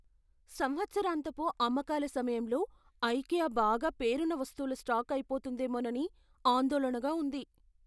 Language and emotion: Telugu, fearful